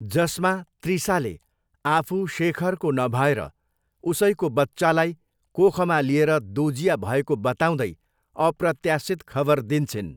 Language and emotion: Nepali, neutral